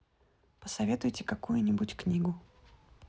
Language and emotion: Russian, neutral